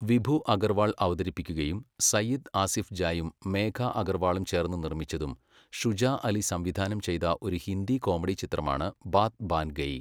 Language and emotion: Malayalam, neutral